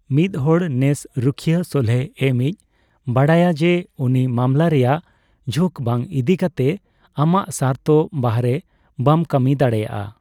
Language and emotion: Santali, neutral